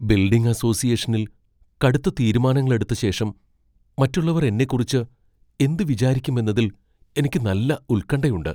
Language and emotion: Malayalam, fearful